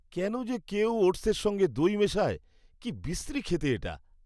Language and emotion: Bengali, disgusted